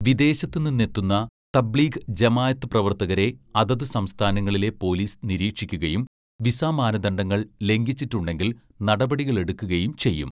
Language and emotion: Malayalam, neutral